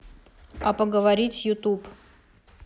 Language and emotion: Russian, neutral